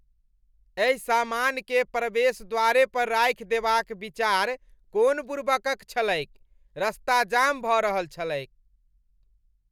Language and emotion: Maithili, disgusted